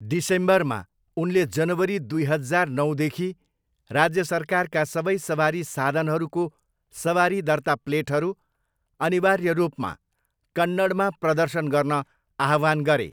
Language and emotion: Nepali, neutral